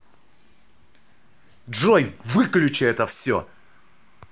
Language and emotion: Russian, angry